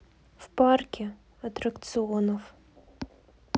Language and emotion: Russian, sad